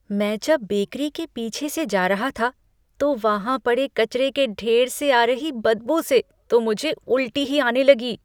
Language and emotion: Hindi, disgusted